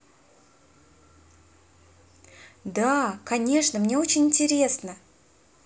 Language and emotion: Russian, positive